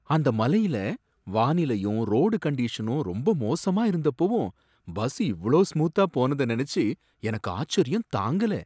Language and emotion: Tamil, surprised